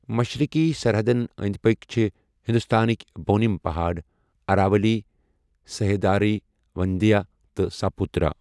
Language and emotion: Kashmiri, neutral